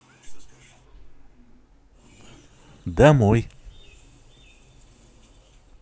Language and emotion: Russian, neutral